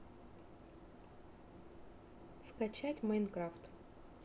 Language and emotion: Russian, neutral